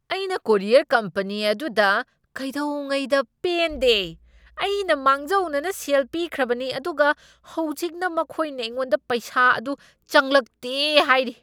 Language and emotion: Manipuri, angry